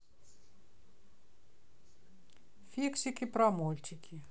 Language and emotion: Russian, neutral